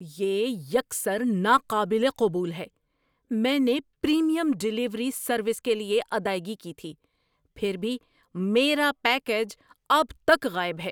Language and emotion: Urdu, angry